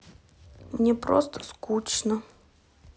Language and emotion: Russian, sad